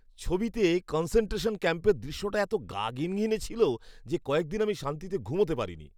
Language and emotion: Bengali, disgusted